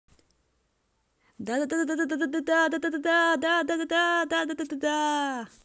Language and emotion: Russian, positive